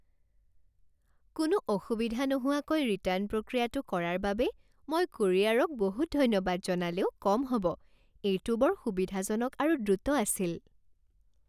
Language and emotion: Assamese, happy